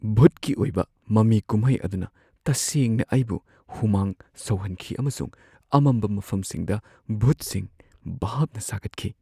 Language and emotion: Manipuri, fearful